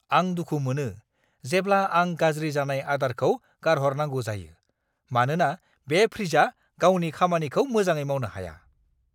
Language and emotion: Bodo, angry